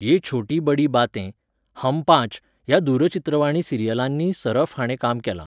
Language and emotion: Goan Konkani, neutral